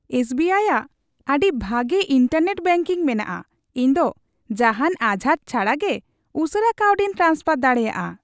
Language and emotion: Santali, happy